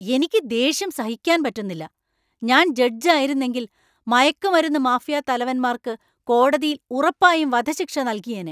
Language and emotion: Malayalam, angry